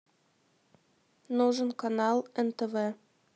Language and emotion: Russian, neutral